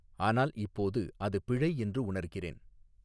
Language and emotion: Tamil, neutral